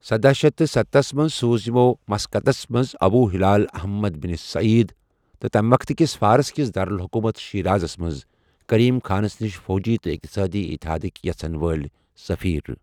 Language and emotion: Kashmiri, neutral